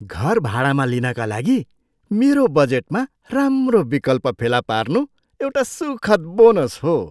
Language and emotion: Nepali, surprised